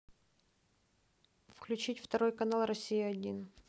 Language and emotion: Russian, neutral